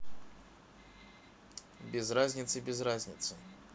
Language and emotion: Russian, neutral